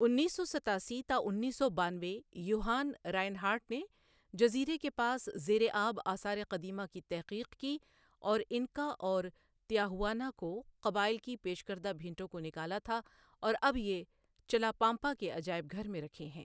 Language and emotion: Urdu, neutral